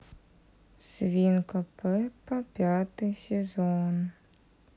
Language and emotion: Russian, sad